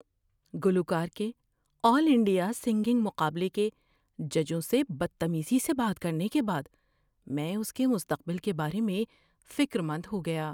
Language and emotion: Urdu, fearful